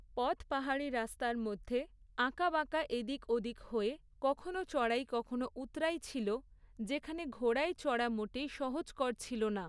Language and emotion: Bengali, neutral